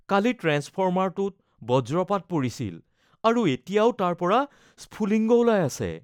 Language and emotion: Assamese, fearful